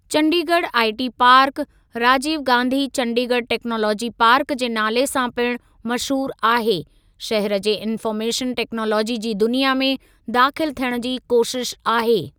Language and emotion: Sindhi, neutral